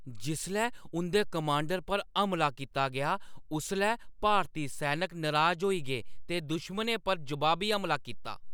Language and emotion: Dogri, angry